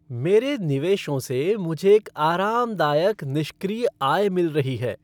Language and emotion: Hindi, happy